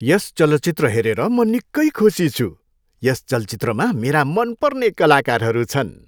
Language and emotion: Nepali, happy